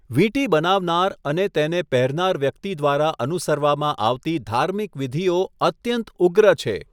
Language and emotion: Gujarati, neutral